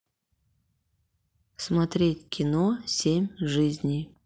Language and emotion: Russian, neutral